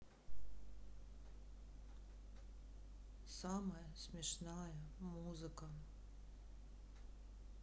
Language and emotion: Russian, sad